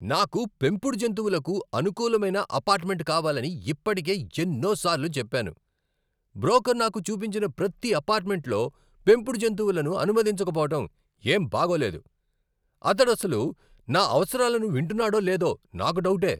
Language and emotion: Telugu, angry